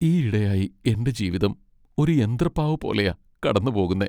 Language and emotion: Malayalam, sad